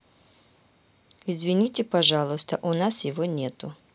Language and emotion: Russian, neutral